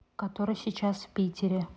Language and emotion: Russian, neutral